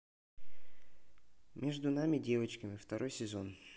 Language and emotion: Russian, neutral